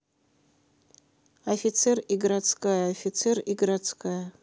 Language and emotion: Russian, neutral